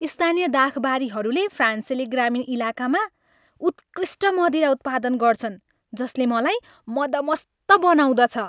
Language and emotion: Nepali, happy